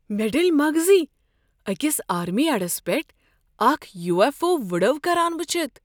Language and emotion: Kashmiri, surprised